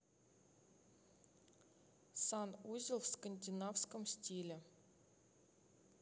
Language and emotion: Russian, neutral